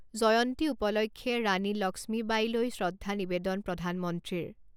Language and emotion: Assamese, neutral